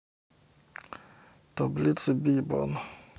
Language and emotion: Russian, neutral